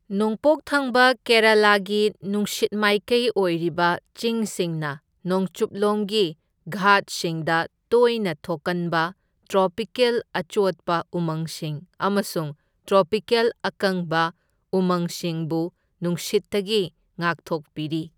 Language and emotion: Manipuri, neutral